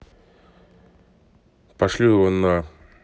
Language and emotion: Russian, angry